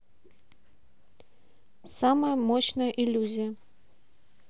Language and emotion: Russian, neutral